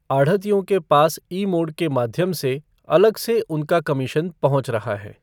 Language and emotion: Hindi, neutral